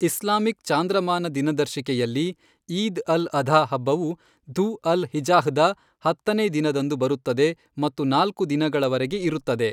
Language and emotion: Kannada, neutral